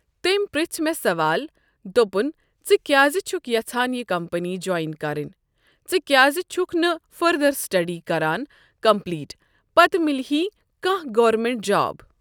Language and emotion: Kashmiri, neutral